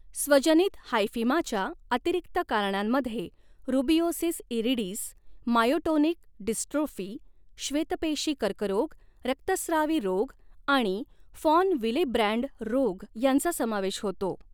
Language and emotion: Marathi, neutral